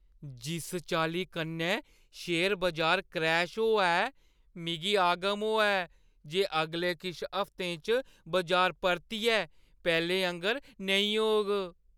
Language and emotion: Dogri, fearful